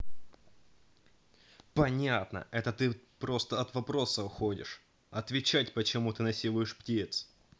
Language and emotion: Russian, angry